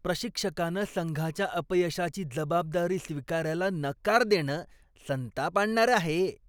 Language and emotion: Marathi, disgusted